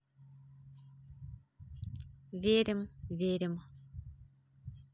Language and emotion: Russian, neutral